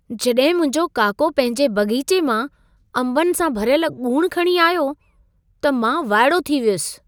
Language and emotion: Sindhi, surprised